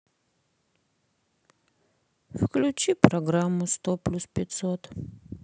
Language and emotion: Russian, sad